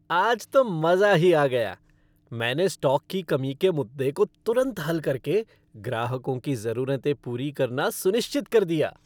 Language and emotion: Hindi, happy